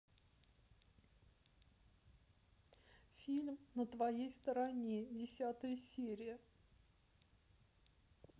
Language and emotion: Russian, sad